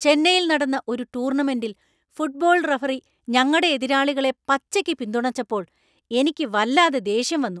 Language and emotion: Malayalam, angry